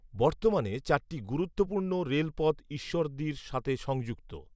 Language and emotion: Bengali, neutral